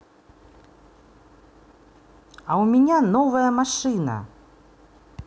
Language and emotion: Russian, positive